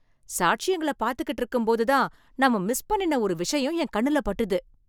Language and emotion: Tamil, surprised